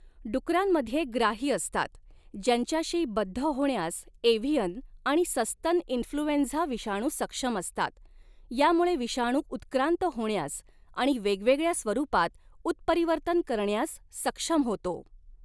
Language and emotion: Marathi, neutral